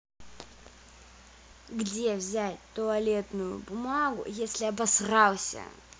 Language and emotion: Russian, angry